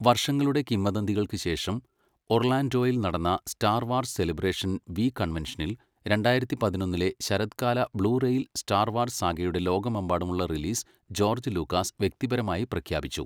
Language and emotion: Malayalam, neutral